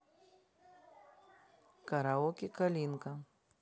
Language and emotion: Russian, neutral